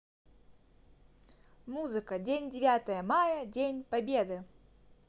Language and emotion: Russian, positive